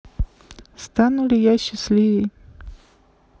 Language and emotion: Russian, sad